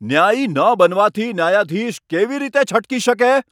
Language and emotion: Gujarati, angry